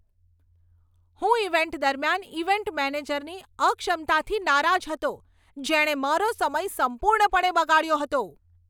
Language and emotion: Gujarati, angry